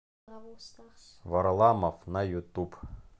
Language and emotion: Russian, neutral